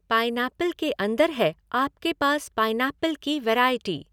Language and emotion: Hindi, neutral